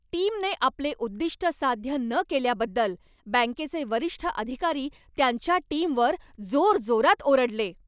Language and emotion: Marathi, angry